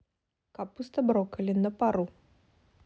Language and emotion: Russian, neutral